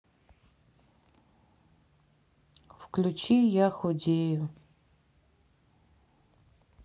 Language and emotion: Russian, sad